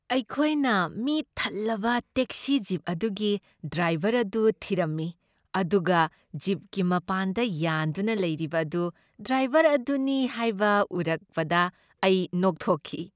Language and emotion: Manipuri, happy